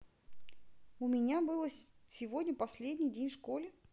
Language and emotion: Russian, neutral